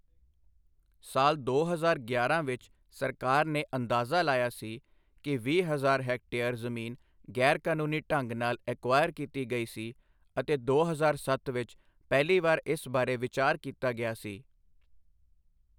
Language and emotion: Punjabi, neutral